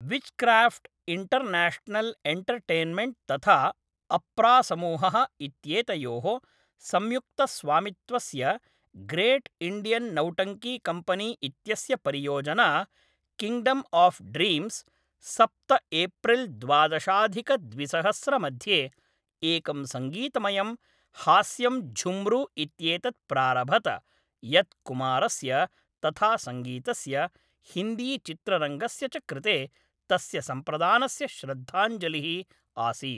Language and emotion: Sanskrit, neutral